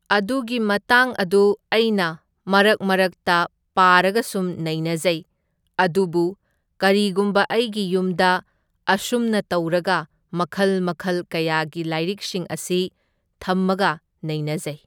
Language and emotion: Manipuri, neutral